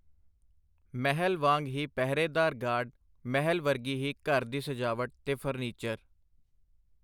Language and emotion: Punjabi, neutral